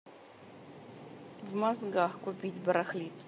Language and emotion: Russian, neutral